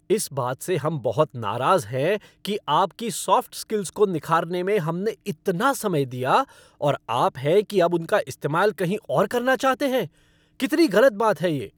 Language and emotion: Hindi, angry